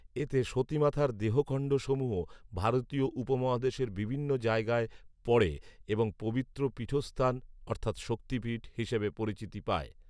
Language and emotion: Bengali, neutral